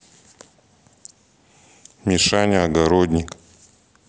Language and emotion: Russian, neutral